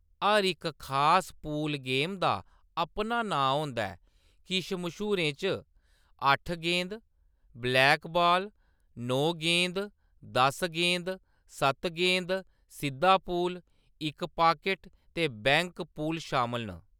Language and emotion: Dogri, neutral